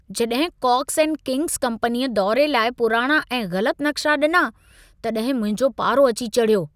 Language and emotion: Sindhi, angry